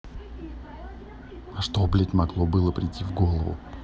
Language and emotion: Russian, angry